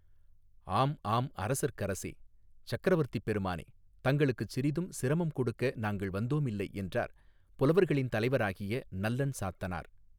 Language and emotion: Tamil, neutral